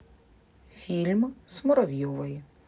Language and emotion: Russian, neutral